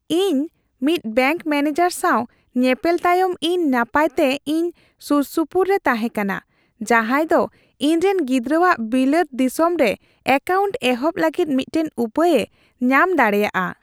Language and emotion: Santali, happy